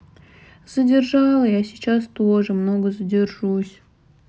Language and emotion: Russian, sad